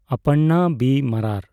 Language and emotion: Santali, neutral